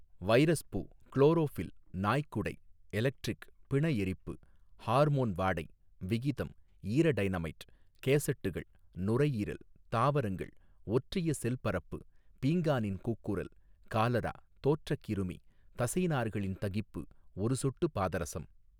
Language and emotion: Tamil, neutral